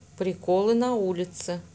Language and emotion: Russian, neutral